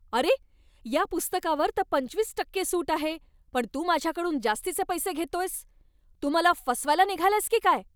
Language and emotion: Marathi, angry